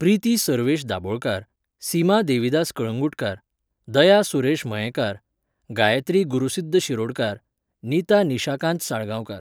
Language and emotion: Goan Konkani, neutral